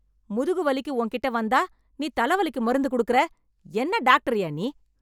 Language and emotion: Tamil, angry